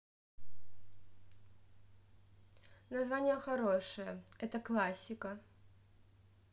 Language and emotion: Russian, neutral